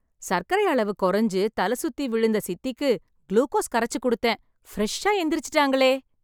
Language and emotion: Tamil, happy